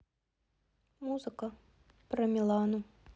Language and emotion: Russian, sad